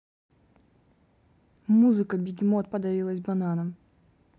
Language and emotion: Russian, neutral